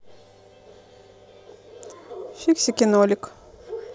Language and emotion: Russian, neutral